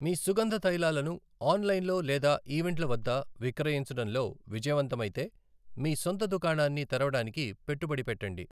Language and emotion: Telugu, neutral